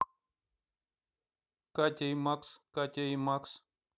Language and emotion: Russian, neutral